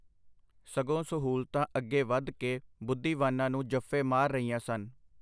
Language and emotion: Punjabi, neutral